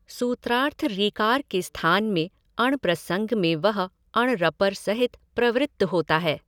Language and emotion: Hindi, neutral